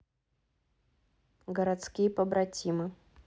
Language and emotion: Russian, neutral